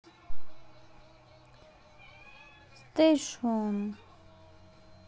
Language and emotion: Russian, neutral